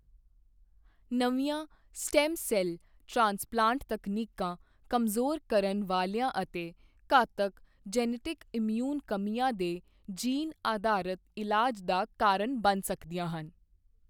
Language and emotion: Punjabi, neutral